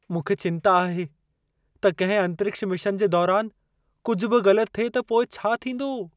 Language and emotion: Sindhi, fearful